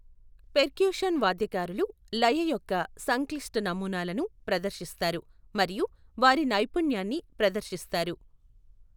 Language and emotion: Telugu, neutral